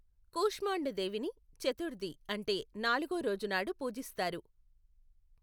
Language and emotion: Telugu, neutral